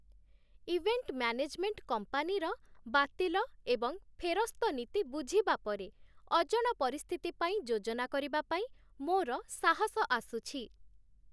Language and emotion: Odia, happy